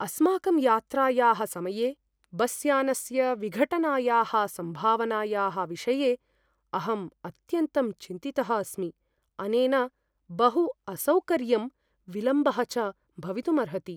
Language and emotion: Sanskrit, fearful